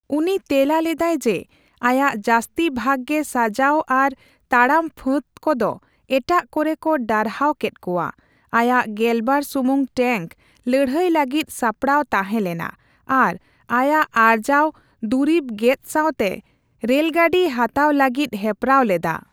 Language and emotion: Santali, neutral